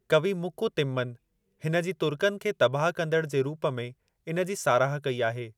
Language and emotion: Sindhi, neutral